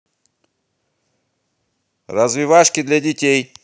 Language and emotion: Russian, positive